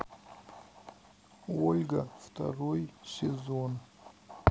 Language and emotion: Russian, sad